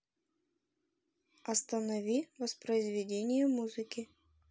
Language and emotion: Russian, neutral